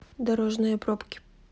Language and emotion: Russian, neutral